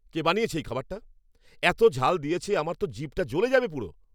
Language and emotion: Bengali, angry